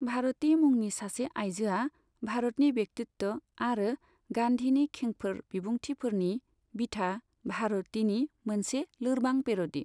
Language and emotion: Bodo, neutral